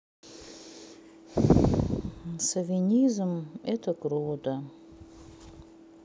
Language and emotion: Russian, sad